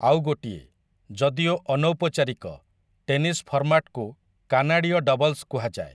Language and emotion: Odia, neutral